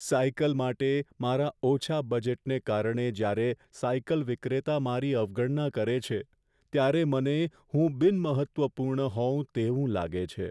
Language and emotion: Gujarati, sad